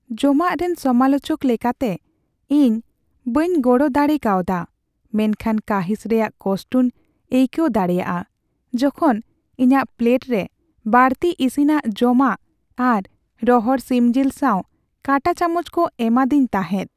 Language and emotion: Santali, sad